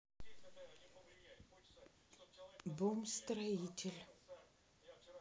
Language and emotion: Russian, neutral